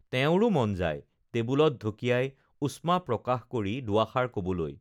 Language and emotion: Assamese, neutral